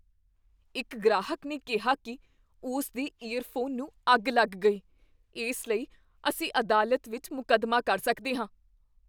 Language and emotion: Punjabi, fearful